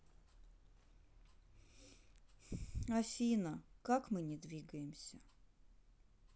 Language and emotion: Russian, sad